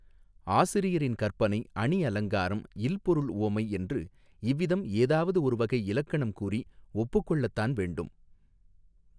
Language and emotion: Tamil, neutral